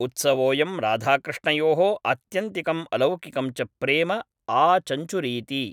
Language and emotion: Sanskrit, neutral